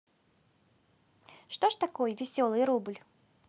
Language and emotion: Russian, positive